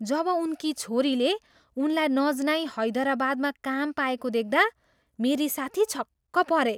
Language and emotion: Nepali, surprised